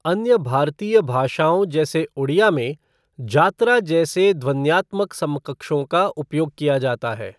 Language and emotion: Hindi, neutral